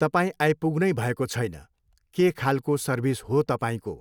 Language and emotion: Nepali, neutral